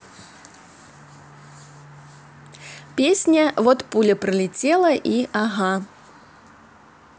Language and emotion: Russian, positive